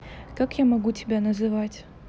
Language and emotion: Russian, neutral